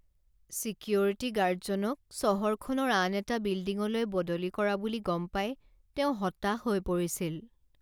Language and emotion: Assamese, sad